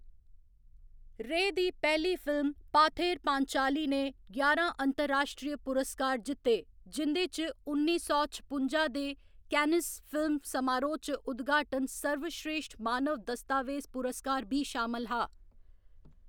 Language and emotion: Dogri, neutral